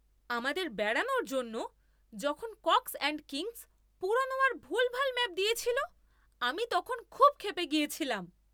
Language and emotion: Bengali, angry